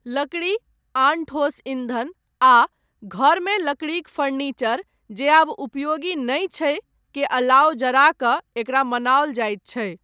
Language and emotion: Maithili, neutral